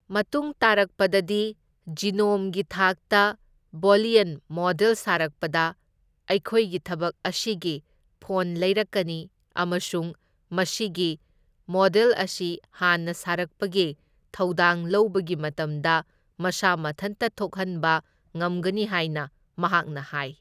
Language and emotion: Manipuri, neutral